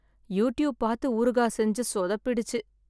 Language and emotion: Tamil, sad